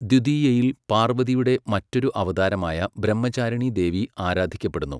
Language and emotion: Malayalam, neutral